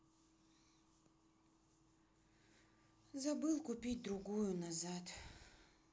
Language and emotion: Russian, sad